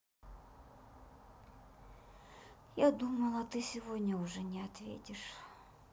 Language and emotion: Russian, sad